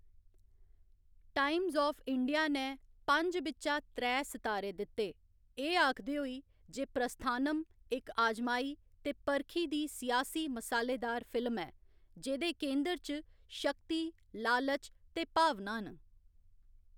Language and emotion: Dogri, neutral